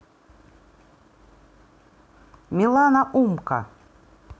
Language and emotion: Russian, neutral